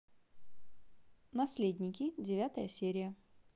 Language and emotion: Russian, positive